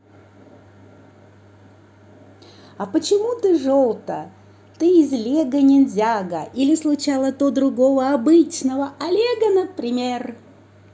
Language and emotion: Russian, positive